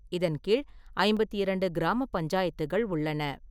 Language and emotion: Tamil, neutral